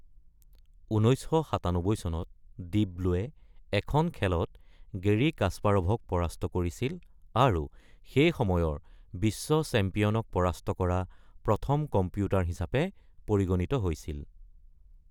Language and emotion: Assamese, neutral